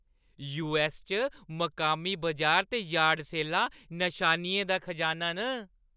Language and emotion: Dogri, happy